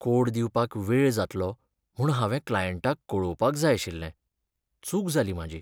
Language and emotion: Goan Konkani, sad